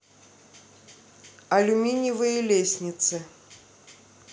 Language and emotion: Russian, neutral